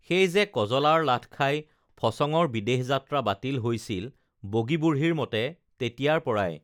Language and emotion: Assamese, neutral